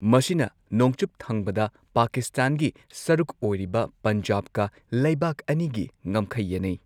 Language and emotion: Manipuri, neutral